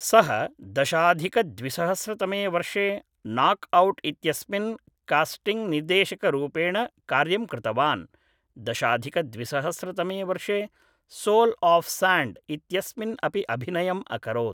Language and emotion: Sanskrit, neutral